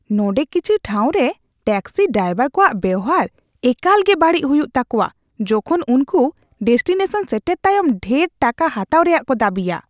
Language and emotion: Santali, disgusted